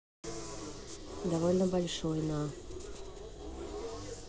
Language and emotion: Russian, neutral